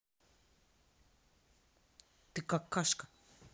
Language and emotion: Russian, angry